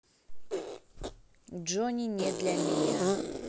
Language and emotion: Russian, neutral